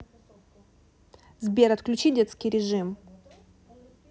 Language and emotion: Russian, neutral